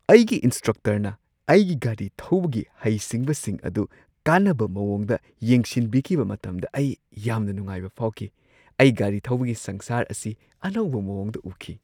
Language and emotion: Manipuri, surprised